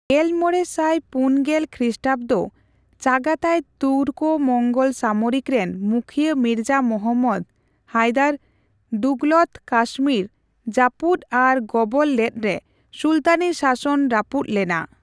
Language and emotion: Santali, neutral